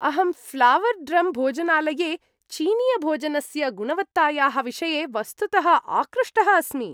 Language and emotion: Sanskrit, happy